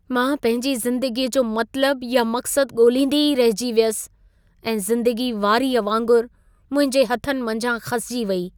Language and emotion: Sindhi, sad